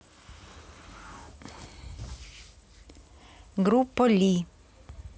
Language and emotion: Russian, neutral